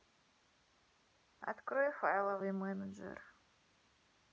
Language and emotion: Russian, neutral